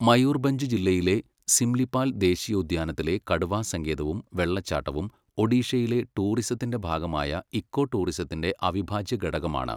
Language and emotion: Malayalam, neutral